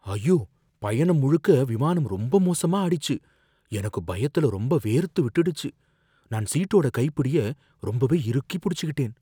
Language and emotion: Tamil, fearful